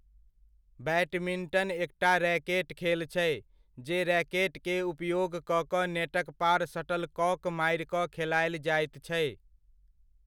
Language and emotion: Maithili, neutral